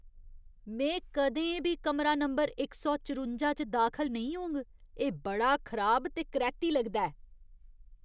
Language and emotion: Dogri, disgusted